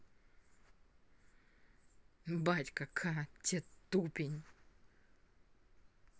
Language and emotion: Russian, angry